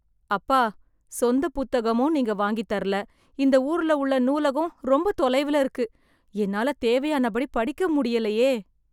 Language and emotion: Tamil, sad